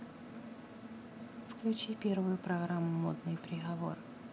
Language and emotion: Russian, neutral